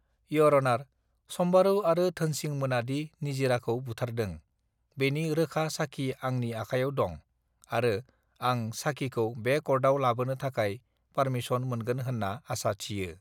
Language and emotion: Bodo, neutral